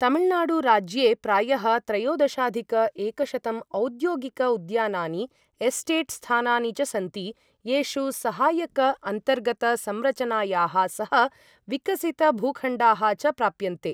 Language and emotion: Sanskrit, neutral